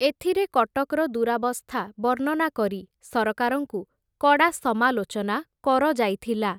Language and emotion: Odia, neutral